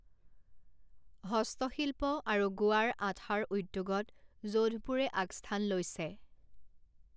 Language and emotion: Assamese, neutral